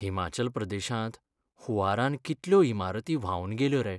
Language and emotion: Goan Konkani, sad